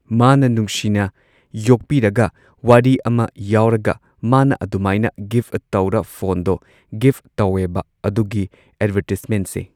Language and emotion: Manipuri, neutral